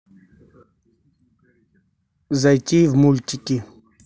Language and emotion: Russian, neutral